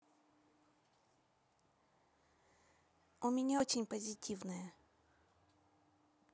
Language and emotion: Russian, neutral